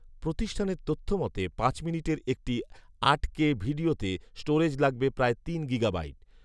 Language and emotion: Bengali, neutral